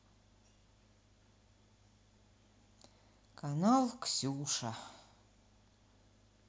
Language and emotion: Russian, sad